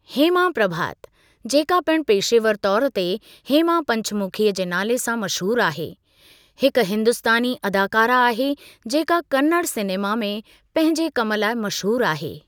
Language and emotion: Sindhi, neutral